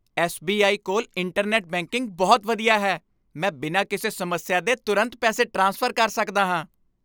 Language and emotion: Punjabi, happy